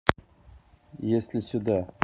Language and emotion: Russian, neutral